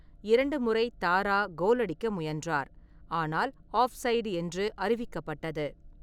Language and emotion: Tamil, neutral